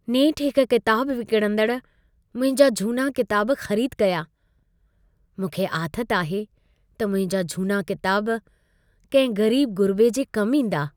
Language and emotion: Sindhi, happy